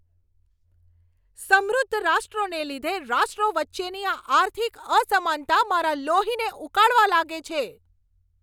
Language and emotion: Gujarati, angry